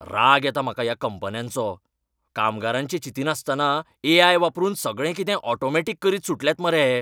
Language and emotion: Goan Konkani, angry